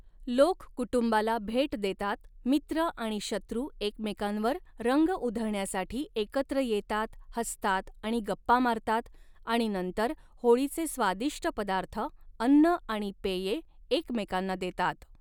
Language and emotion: Marathi, neutral